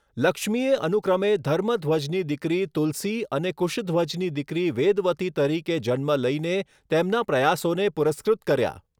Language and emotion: Gujarati, neutral